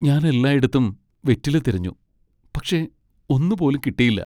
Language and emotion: Malayalam, sad